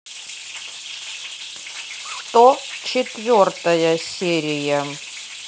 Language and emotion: Russian, neutral